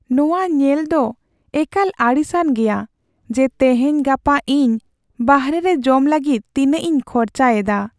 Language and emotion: Santali, sad